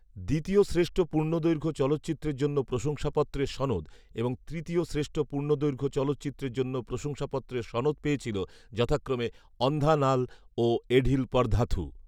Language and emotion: Bengali, neutral